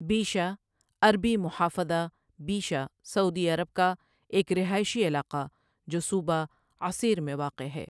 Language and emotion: Urdu, neutral